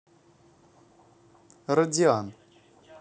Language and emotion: Russian, neutral